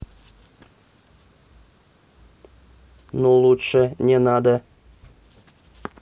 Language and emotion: Russian, neutral